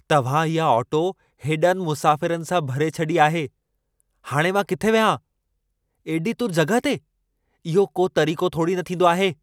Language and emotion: Sindhi, angry